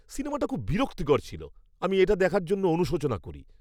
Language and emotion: Bengali, disgusted